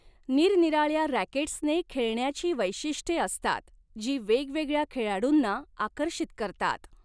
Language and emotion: Marathi, neutral